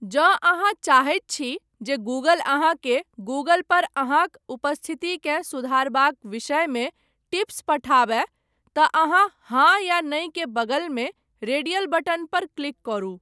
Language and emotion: Maithili, neutral